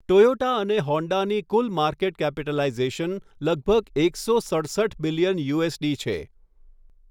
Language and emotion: Gujarati, neutral